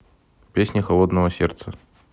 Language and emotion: Russian, neutral